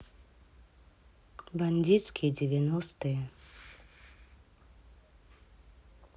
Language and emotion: Russian, neutral